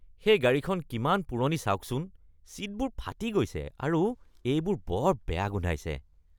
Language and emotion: Assamese, disgusted